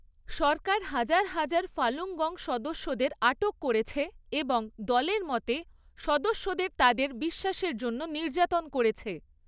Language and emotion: Bengali, neutral